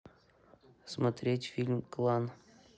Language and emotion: Russian, neutral